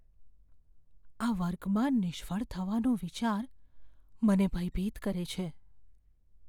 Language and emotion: Gujarati, fearful